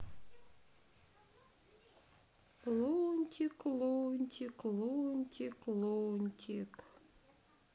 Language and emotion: Russian, sad